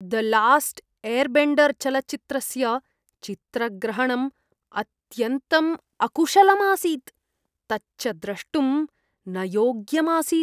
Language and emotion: Sanskrit, disgusted